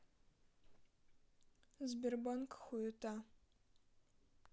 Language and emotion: Russian, neutral